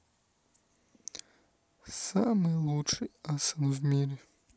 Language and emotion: Russian, neutral